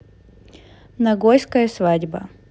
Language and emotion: Russian, neutral